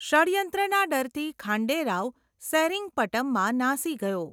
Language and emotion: Gujarati, neutral